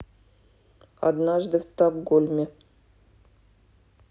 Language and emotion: Russian, neutral